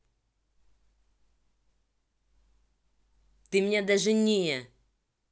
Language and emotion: Russian, angry